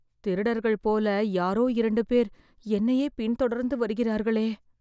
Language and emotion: Tamil, fearful